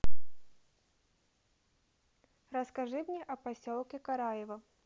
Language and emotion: Russian, neutral